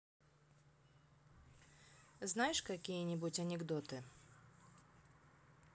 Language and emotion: Russian, neutral